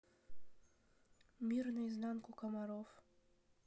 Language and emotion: Russian, neutral